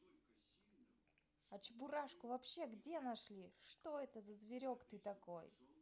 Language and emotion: Russian, positive